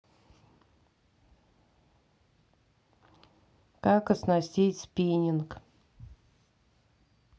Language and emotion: Russian, neutral